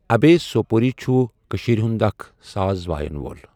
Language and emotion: Kashmiri, neutral